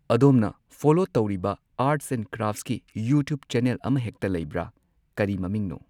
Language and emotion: Manipuri, neutral